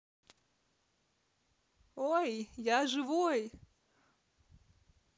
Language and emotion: Russian, positive